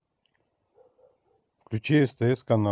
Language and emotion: Russian, neutral